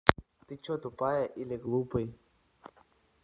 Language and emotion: Russian, neutral